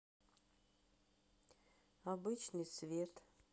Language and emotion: Russian, sad